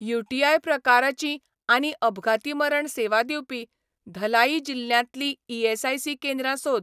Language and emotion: Goan Konkani, neutral